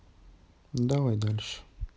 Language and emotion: Russian, neutral